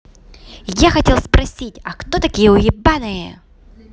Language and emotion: Russian, positive